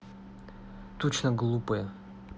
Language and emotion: Russian, angry